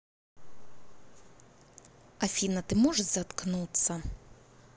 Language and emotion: Russian, angry